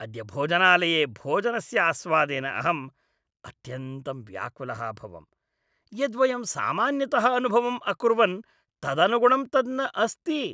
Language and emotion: Sanskrit, disgusted